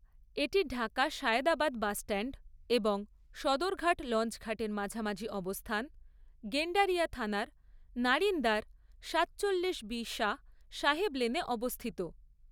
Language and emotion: Bengali, neutral